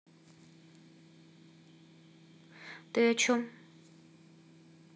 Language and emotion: Russian, neutral